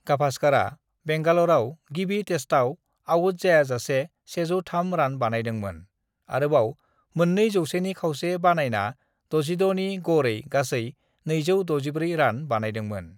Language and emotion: Bodo, neutral